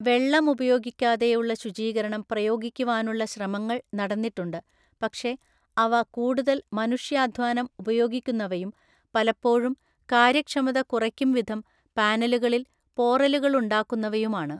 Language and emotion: Malayalam, neutral